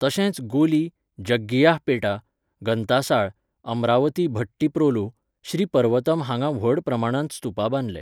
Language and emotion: Goan Konkani, neutral